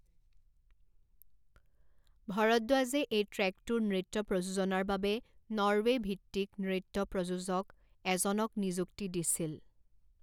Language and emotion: Assamese, neutral